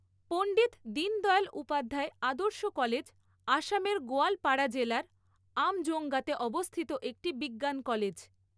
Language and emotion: Bengali, neutral